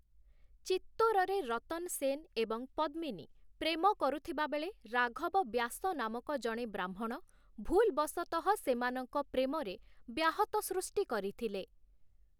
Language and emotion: Odia, neutral